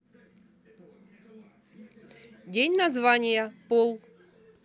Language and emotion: Russian, neutral